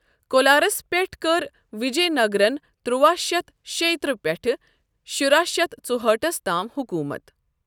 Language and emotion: Kashmiri, neutral